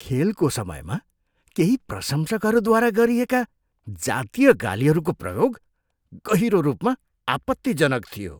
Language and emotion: Nepali, disgusted